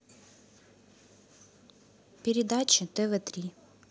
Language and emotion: Russian, neutral